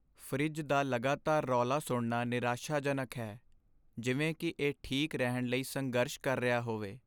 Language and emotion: Punjabi, sad